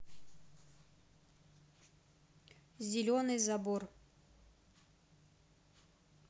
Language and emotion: Russian, neutral